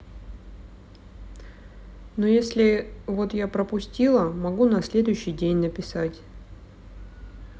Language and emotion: Russian, neutral